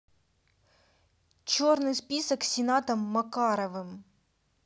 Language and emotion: Russian, neutral